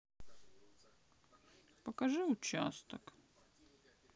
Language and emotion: Russian, sad